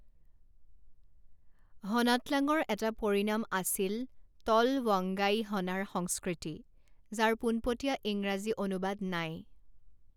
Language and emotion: Assamese, neutral